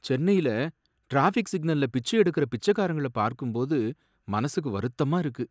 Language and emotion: Tamil, sad